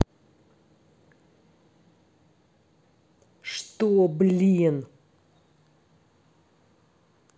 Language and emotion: Russian, angry